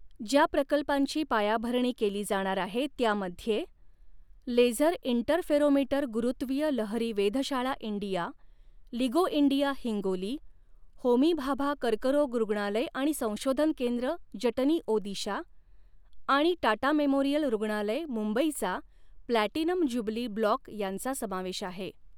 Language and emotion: Marathi, neutral